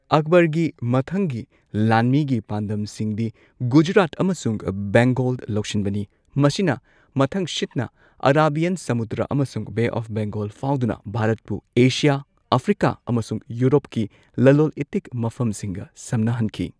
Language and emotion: Manipuri, neutral